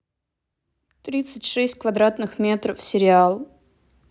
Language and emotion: Russian, neutral